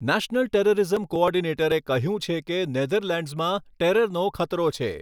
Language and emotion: Gujarati, neutral